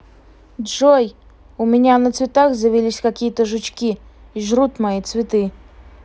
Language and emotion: Russian, angry